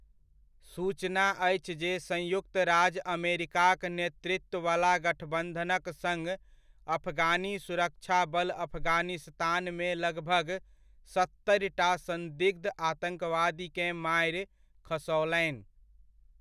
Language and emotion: Maithili, neutral